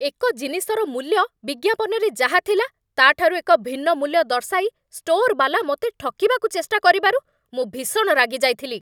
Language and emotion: Odia, angry